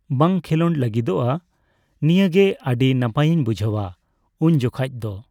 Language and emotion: Santali, neutral